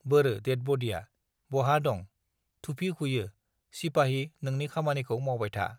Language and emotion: Bodo, neutral